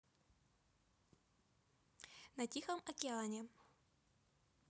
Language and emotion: Russian, neutral